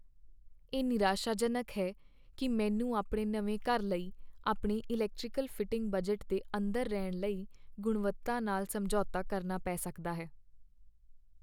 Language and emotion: Punjabi, sad